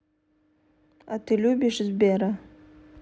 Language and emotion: Russian, neutral